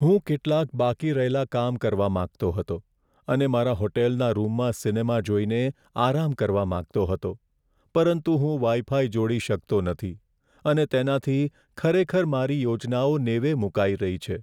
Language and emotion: Gujarati, sad